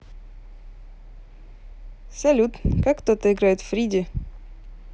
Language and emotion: Russian, positive